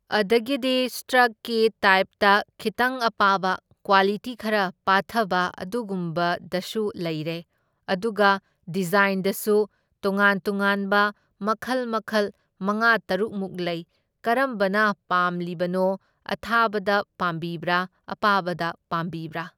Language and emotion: Manipuri, neutral